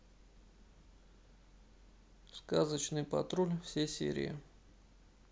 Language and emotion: Russian, neutral